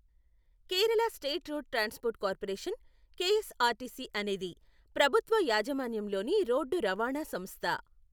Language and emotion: Telugu, neutral